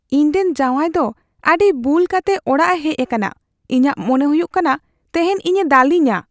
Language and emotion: Santali, fearful